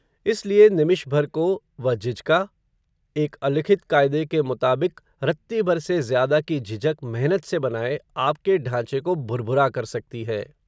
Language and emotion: Hindi, neutral